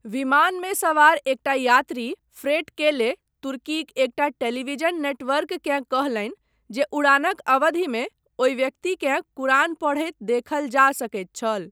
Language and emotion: Maithili, neutral